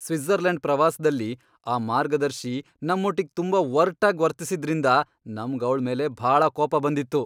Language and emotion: Kannada, angry